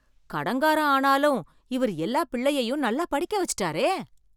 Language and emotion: Tamil, surprised